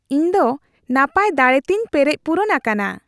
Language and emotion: Santali, happy